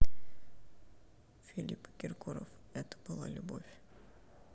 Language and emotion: Russian, sad